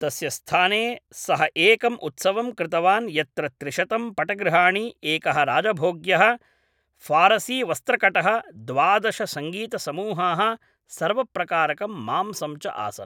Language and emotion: Sanskrit, neutral